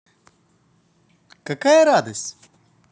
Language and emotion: Russian, positive